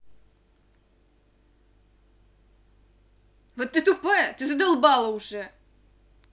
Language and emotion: Russian, angry